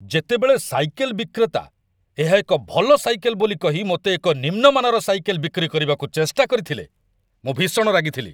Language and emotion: Odia, angry